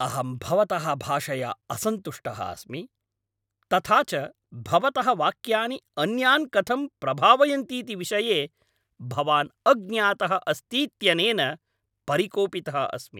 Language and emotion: Sanskrit, angry